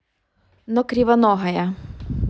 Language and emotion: Russian, neutral